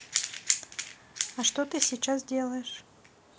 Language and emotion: Russian, neutral